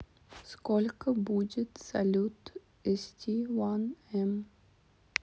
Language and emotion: Russian, neutral